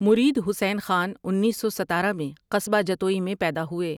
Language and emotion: Urdu, neutral